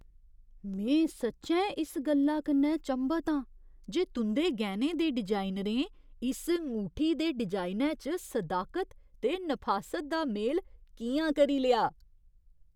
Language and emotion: Dogri, surprised